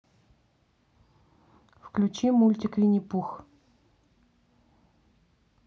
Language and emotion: Russian, neutral